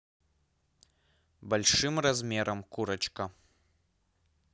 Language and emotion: Russian, neutral